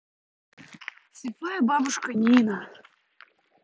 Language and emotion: Russian, neutral